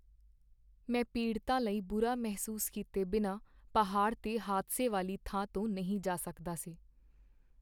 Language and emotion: Punjabi, sad